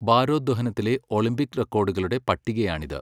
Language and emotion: Malayalam, neutral